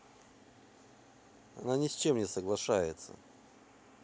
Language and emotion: Russian, neutral